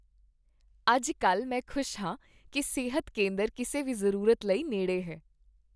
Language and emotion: Punjabi, happy